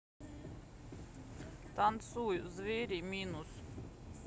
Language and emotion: Russian, neutral